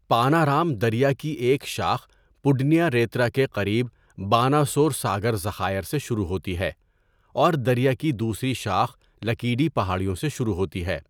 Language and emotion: Urdu, neutral